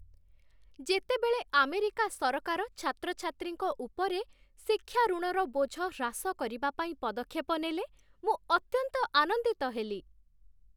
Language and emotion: Odia, happy